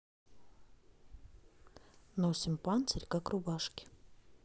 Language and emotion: Russian, neutral